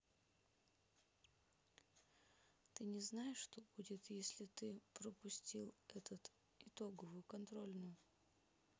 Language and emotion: Russian, sad